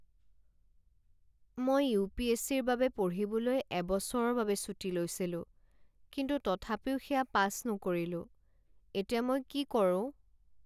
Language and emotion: Assamese, sad